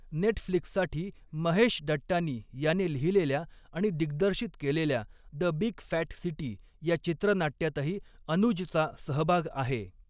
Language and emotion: Marathi, neutral